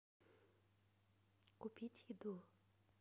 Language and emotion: Russian, neutral